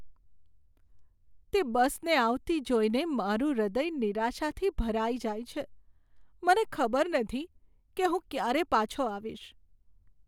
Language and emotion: Gujarati, sad